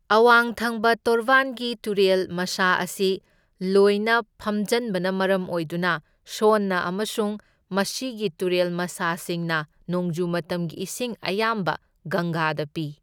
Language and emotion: Manipuri, neutral